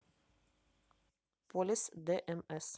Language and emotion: Russian, neutral